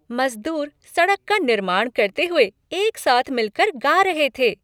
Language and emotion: Hindi, happy